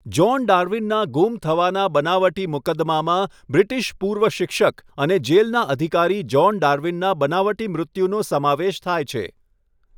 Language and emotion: Gujarati, neutral